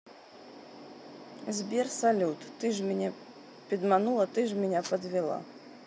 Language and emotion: Russian, neutral